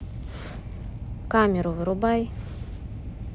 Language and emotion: Russian, angry